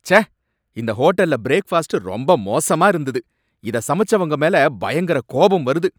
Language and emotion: Tamil, angry